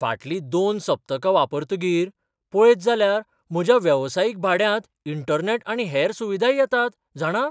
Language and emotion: Goan Konkani, surprised